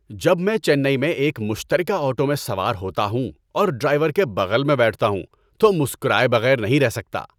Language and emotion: Urdu, happy